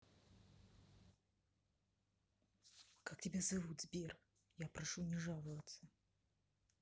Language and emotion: Russian, neutral